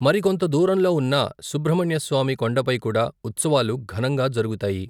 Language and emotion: Telugu, neutral